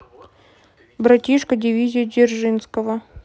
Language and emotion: Russian, neutral